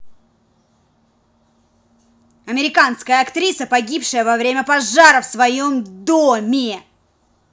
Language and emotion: Russian, angry